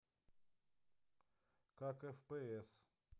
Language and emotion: Russian, neutral